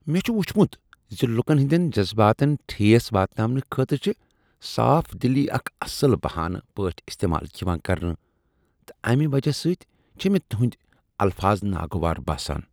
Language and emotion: Kashmiri, disgusted